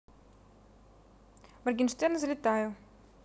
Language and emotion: Russian, neutral